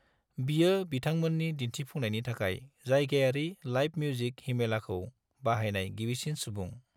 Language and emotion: Bodo, neutral